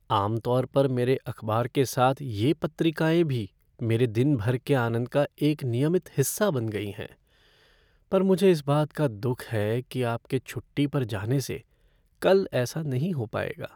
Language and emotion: Hindi, sad